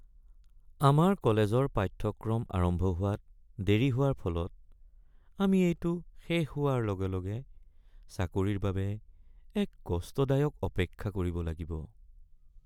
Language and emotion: Assamese, sad